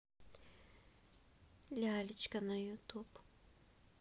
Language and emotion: Russian, neutral